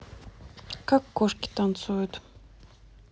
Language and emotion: Russian, neutral